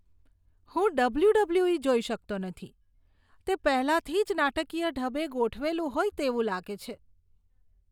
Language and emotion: Gujarati, disgusted